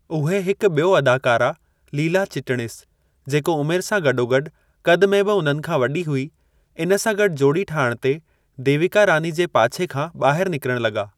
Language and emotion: Sindhi, neutral